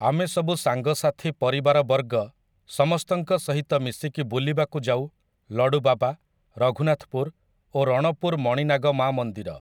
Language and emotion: Odia, neutral